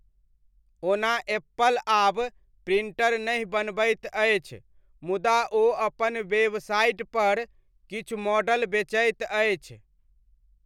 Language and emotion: Maithili, neutral